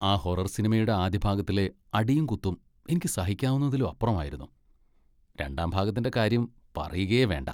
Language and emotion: Malayalam, disgusted